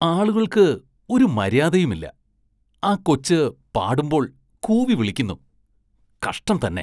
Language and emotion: Malayalam, disgusted